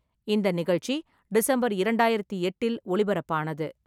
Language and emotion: Tamil, neutral